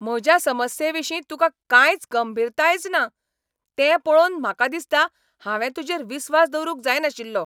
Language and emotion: Goan Konkani, angry